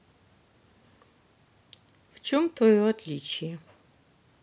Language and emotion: Russian, neutral